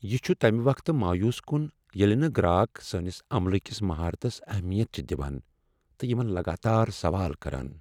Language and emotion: Kashmiri, sad